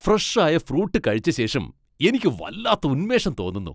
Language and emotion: Malayalam, happy